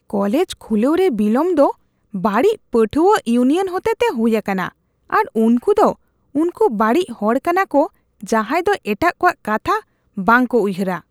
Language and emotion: Santali, disgusted